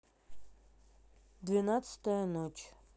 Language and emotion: Russian, neutral